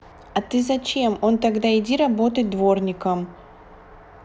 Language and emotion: Russian, neutral